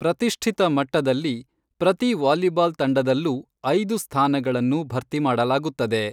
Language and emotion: Kannada, neutral